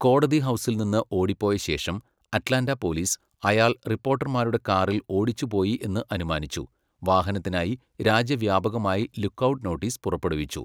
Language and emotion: Malayalam, neutral